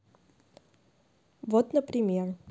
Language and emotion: Russian, neutral